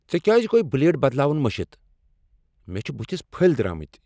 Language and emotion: Kashmiri, angry